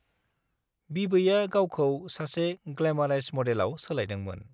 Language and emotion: Bodo, neutral